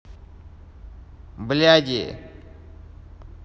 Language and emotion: Russian, angry